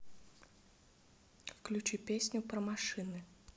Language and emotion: Russian, neutral